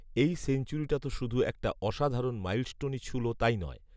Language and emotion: Bengali, neutral